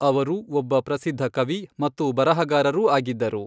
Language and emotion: Kannada, neutral